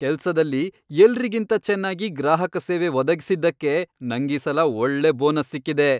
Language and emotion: Kannada, happy